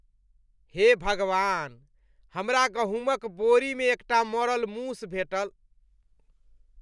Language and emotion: Maithili, disgusted